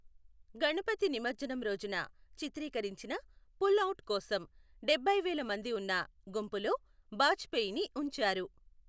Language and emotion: Telugu, neutral